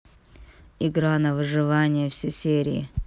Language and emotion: Russian, neutral